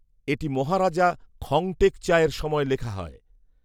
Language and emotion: Bengali, neutral